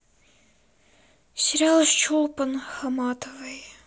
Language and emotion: Russian, sad